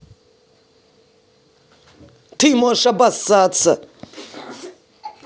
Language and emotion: Russian, angry